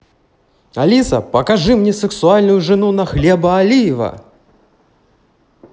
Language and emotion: Russian, neutral